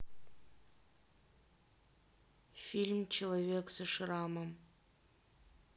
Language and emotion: Russian, neutral